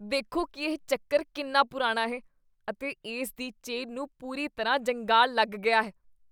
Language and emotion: Punjabi, disgusted